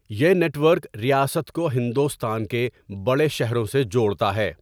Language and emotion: Urdu, neutral